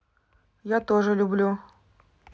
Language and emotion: Russian, neutral